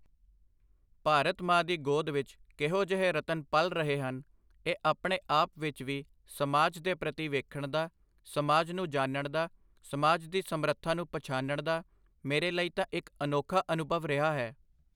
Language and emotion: Punjabi, neutral